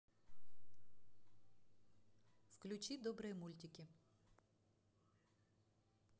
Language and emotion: Russian, neutral